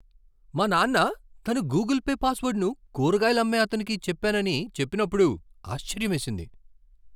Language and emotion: Telugu, surprised